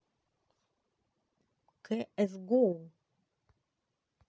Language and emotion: Russian, neutral